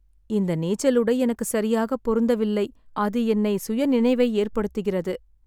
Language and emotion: Tamil, sad